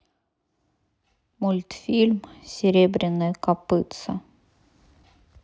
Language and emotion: Russian, sad